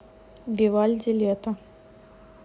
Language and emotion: Russian, neutral